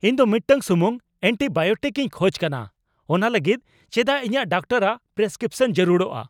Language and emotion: Santali, angry